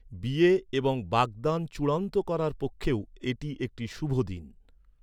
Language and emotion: Bengali, neutral